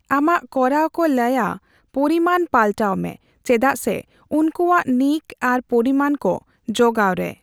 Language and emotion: Santali, neutral